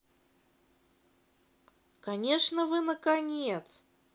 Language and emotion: Russian, positive